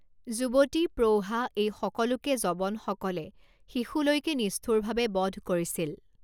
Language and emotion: Assamese, neutral